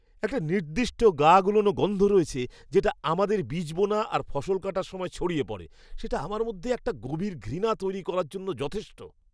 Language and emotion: Bengali, disgusted